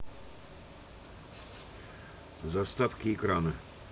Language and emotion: Russian, neutral